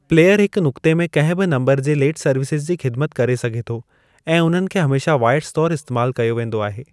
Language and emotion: Sindhi, neutral